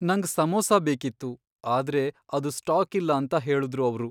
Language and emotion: Kannada, sad